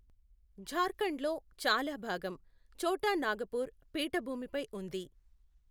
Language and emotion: Telugu, neutral